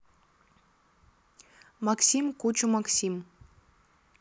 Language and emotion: Russian, neutral